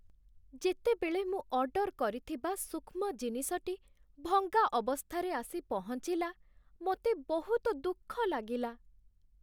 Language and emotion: Odia, sad